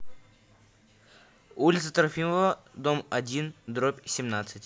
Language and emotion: Russian, neutral